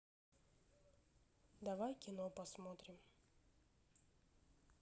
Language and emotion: Russian, neutral